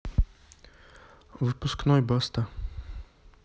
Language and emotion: Russian, neutral